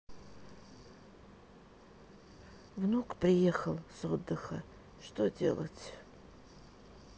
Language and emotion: Russian, sad